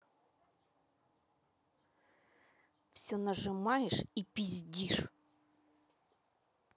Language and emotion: Russian, angry